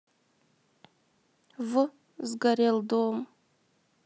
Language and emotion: Russian, sad